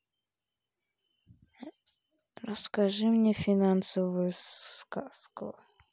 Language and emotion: Russian, neutral